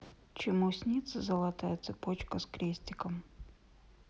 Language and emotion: Russian, neutral